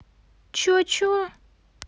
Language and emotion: Russian, angry